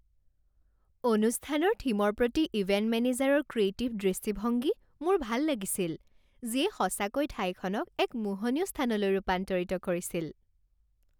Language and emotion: Assamese, happy